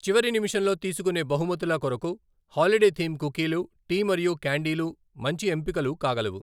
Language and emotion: Telugu, neutral